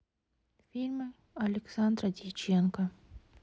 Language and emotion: Russian, neutral